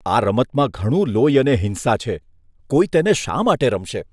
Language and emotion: Gujarati, disgusted